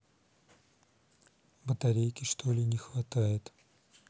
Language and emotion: Russian, neutral